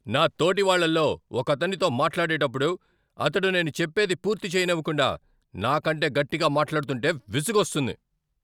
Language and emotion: Telugu, angry